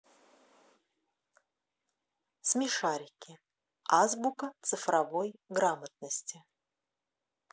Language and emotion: Russian, neutral